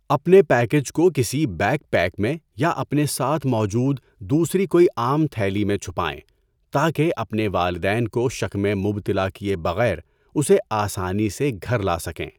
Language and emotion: Urdu, neutral